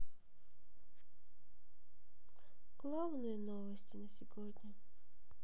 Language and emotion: Russian, sad